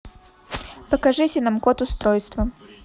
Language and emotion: Russian, neutral